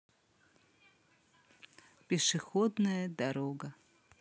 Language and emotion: Russian, neutral